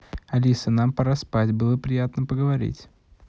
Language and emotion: Russian, positive